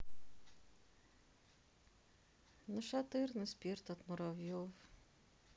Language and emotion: Russian, sad